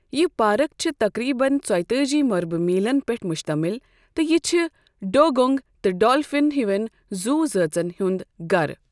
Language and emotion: Kashmiri, neutral